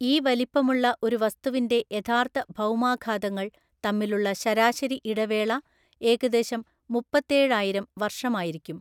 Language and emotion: Malayalam, neutral